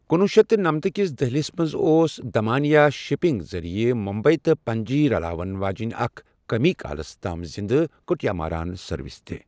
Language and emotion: Kashmiri, neutral